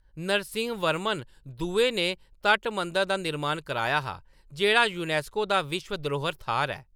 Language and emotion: Dogri, neutral